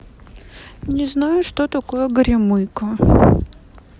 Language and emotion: Russian, sad